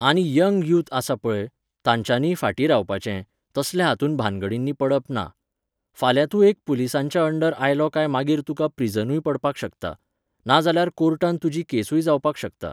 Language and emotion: Goan Konkani, neutral